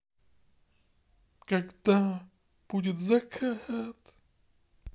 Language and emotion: Russian, sad